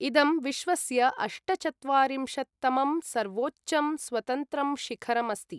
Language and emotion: Sanskrit, neutral